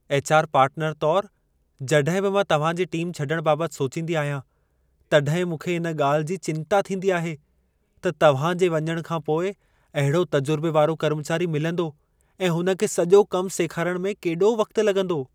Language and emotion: Sindhi, fearful